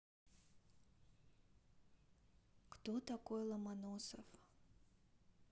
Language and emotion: Russian, neutral